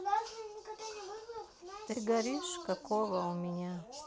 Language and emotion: Russian, neutral